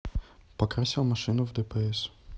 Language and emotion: Russian, neutral